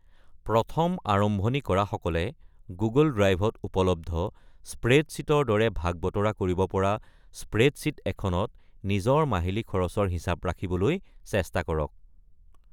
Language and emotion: Assamese, neutral